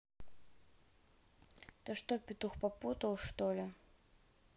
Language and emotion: Russian, neutral